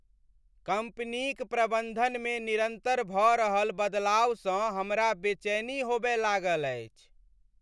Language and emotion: Maithili, sad